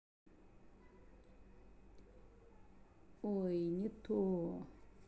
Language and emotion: Russian, sad